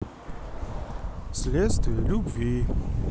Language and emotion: Russian, neutral